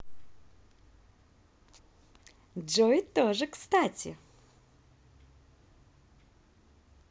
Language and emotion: Russian, positive